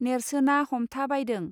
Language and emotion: Bodo, neutral